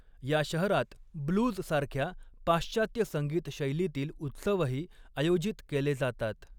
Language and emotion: Marathi, neutral